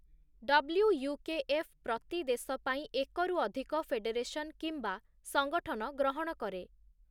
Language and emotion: Odia, neutral